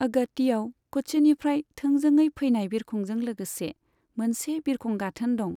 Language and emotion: Bodo, neutral